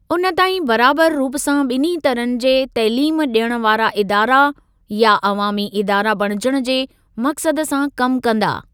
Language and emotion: Sindhi, neutral